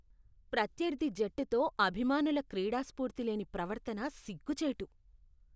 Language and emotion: Telugu, disgusted